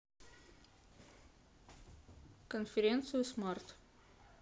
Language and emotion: Russian, neutral